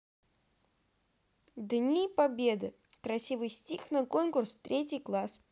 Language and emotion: Russian, positive